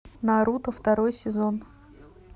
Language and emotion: Russian, neutral